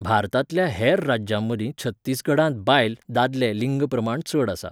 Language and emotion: Goan Konkani, neutral